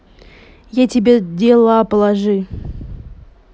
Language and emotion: Russian, neutral